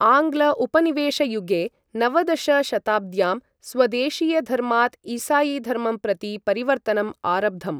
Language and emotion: Sanskrit, neutral